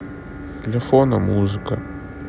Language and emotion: Russian, sad